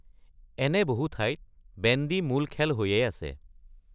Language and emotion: Assamese, neutral